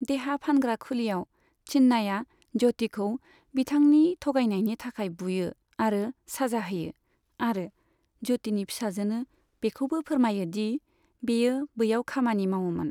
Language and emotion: Bodo, neutral